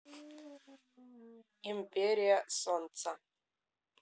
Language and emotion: Russian, neutral